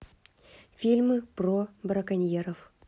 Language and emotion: Russian, neutral